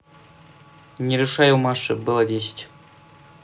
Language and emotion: Russian, neutral